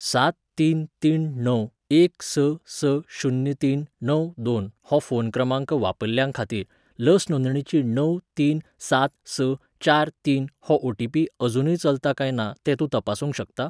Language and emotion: Goan Konkani, neutral